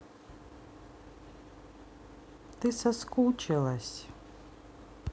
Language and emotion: Russian, sad